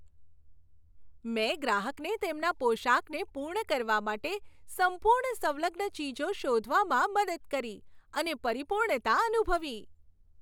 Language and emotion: Gujarati, happy